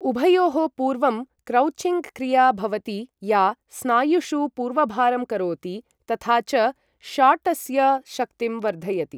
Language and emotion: Sanskrit, neutral